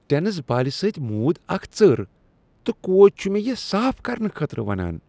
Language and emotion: Kashmiri, disgusted